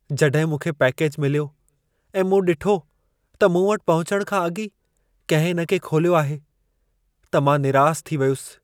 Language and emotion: Sindhi, sad